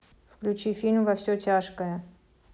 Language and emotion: Russian, neutral